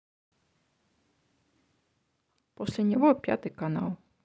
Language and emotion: Russian, neutral